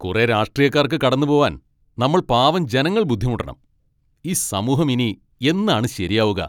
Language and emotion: Malayalam, angry